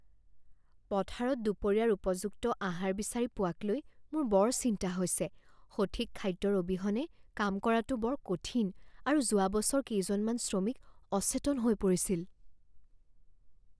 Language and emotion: Assamese, fearful